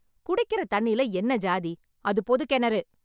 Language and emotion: Tamil, angry